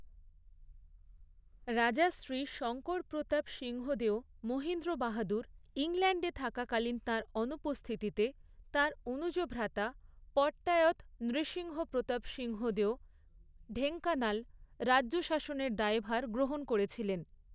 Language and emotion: Bengali, neutral